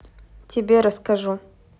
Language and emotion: Russian, neutral